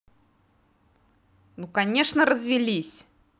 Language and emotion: Russian, angry